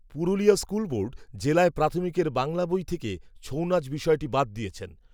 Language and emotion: Bengali, neutral